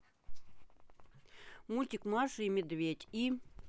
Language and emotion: Russian, neutral